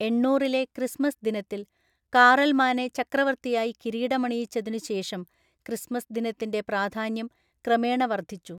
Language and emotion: Malayalam, neutral